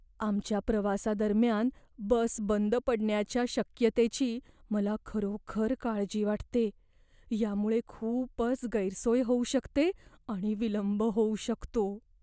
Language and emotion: Marathi, fearful